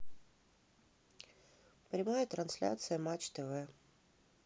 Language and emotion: Russian, neutral